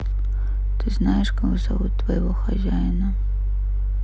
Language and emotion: Russian, sad